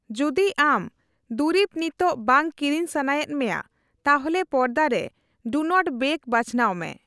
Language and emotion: Santali, neutral